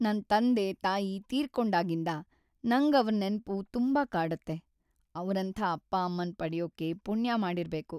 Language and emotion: Kannada, sad